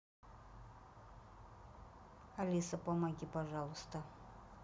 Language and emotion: Russian, neutral